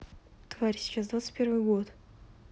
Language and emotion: Russian, neutral